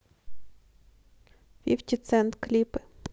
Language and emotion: Russian, neutral